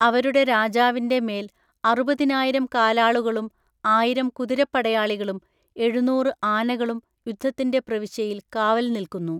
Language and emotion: Malayalam, neutral